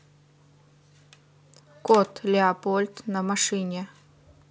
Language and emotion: Russian, neutral